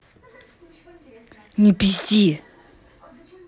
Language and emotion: Russian, angry